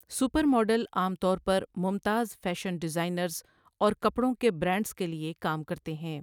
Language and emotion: Urdu, neutral